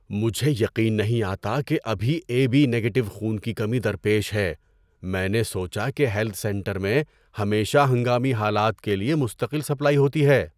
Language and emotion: Urdu, surprised